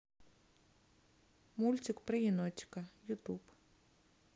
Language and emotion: Russian, neutral